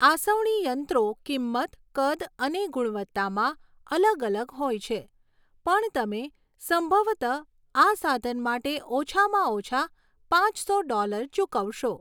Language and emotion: Gujarati, neutral